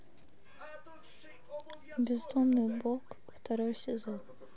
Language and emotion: Russian, neutral